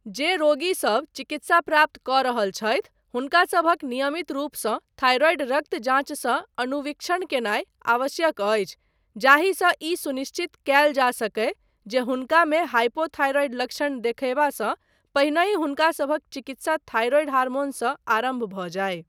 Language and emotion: Maithili, neutral